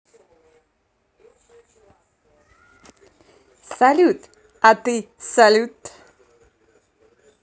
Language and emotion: Russian, positive